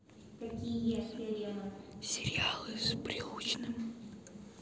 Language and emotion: Russian, neutral